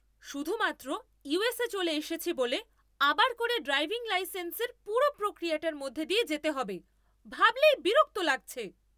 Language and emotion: Bengali, angry